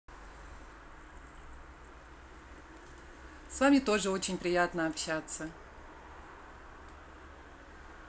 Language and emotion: Russian, positive